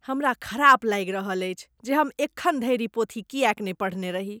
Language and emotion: Maithili, disgusted